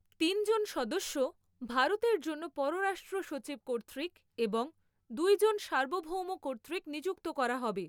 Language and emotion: Bengali, neutral